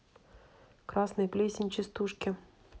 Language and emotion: Russian, neutral